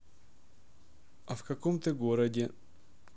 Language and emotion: Russian, neutral